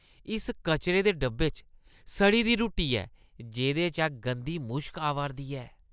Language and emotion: Dogri, disgusted